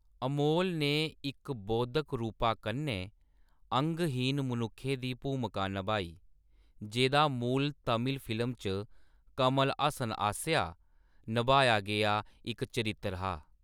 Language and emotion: Dogri, neutral